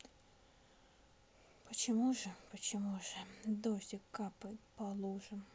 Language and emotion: Russian, sad